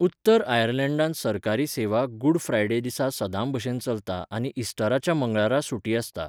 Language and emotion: Goan Konkani, neutral